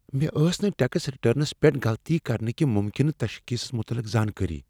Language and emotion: Kashmiri, fearful